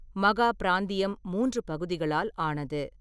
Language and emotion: Tamil, neutral